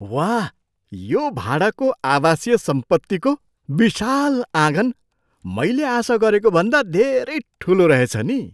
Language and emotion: Nepali, surprised